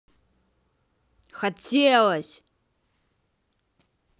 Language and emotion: Russian, angry